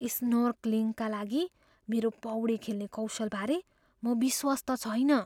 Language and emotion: Nepali, fearful